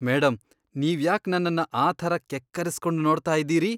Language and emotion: Kannada, disgusted